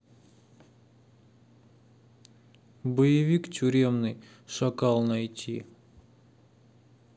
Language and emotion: Russian, neutral